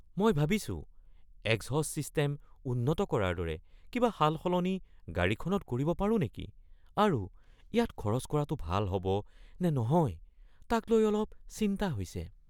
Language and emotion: Assamese, fearful